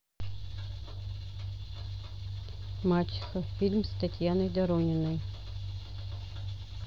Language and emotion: Russian, neutral